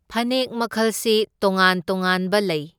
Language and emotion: Manipuri, neutral